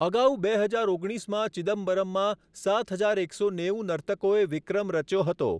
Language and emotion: Gujarati, neutral